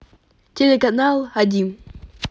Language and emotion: Russian, positive